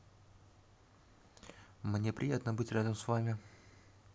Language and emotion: Russian, neutral